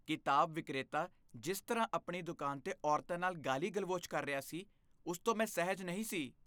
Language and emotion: Punjabi, disgusted